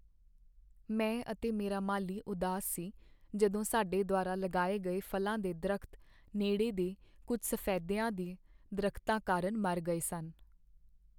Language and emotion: Punjabi, sad